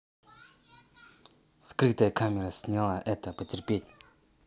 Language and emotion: Russian, angry